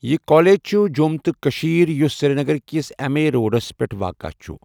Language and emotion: Kashmiri, neutral